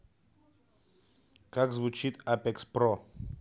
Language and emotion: Russian, neutral